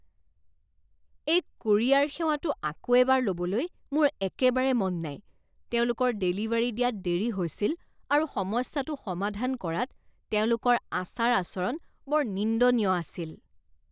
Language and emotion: Assamese, disgusted